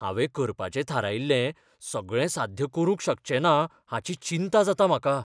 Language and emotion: Goan Konkani, fearful